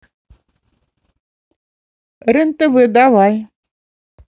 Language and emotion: Russian, positive